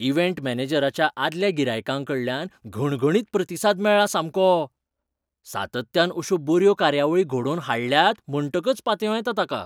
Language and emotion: Goan Konkani, surprised